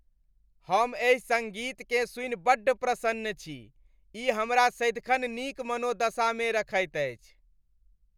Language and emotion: Maithili, happy